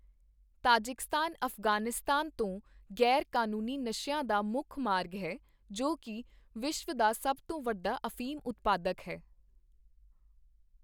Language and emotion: Punjabi, neutral